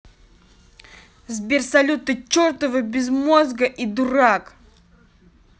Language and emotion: Russian, angry